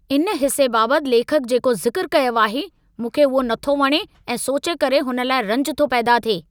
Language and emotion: Sindhi, angry